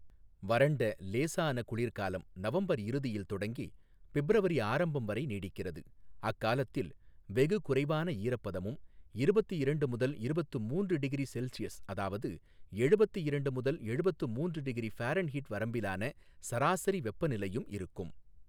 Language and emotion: Tamil, neutral